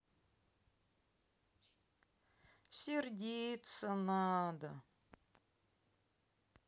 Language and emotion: Russian, sad